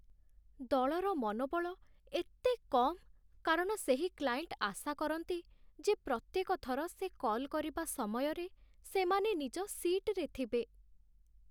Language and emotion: Odia, sad